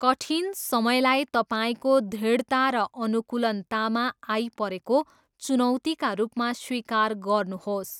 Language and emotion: Nepali, neutral